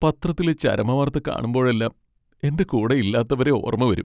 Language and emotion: Malayalam, sad